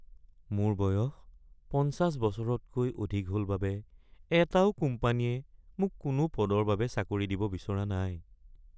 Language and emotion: Assamese, sad